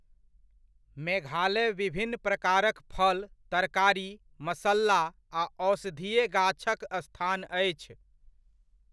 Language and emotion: Maithili, neutral